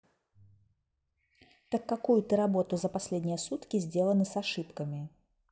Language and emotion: Russian, neutral